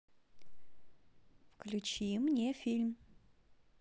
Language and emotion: Russian, neutral